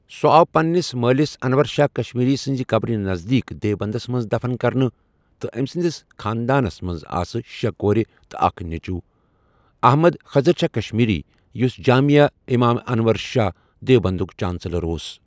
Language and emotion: Kashmiri, neutral